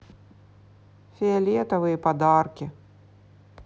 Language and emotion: Russian, neutral